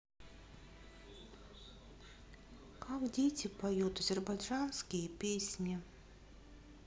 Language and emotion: Russian, sad